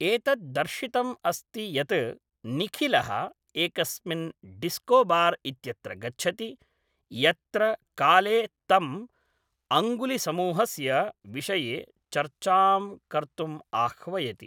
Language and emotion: Sanskrit, neutral